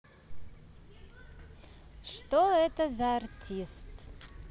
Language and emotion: Russian, positive